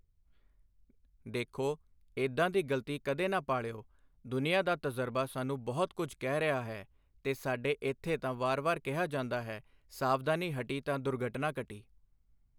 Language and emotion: Punjabi, neutral